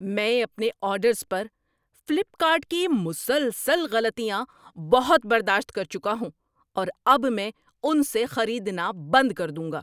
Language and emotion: Urdu, angry